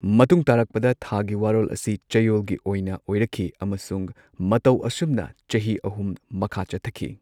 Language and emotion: Manipuri, neutral